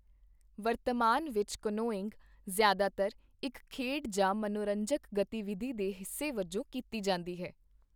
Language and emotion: Punjabi, neutral